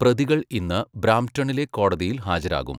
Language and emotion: Malayalam, neutral